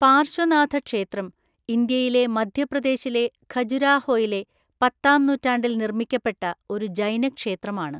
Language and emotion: Malayalam, neutral